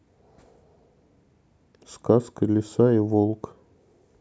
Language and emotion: Russian, neutral